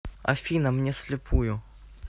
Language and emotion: Russian, neutral